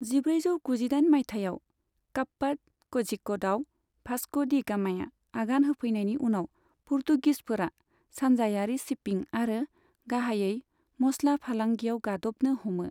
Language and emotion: Bodo, neutral